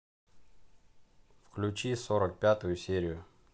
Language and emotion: Russian, neutral